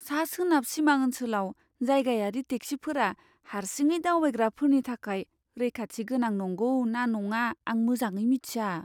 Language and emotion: Bodo, fearful